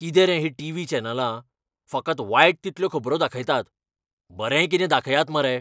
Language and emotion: Goan Konkani, angry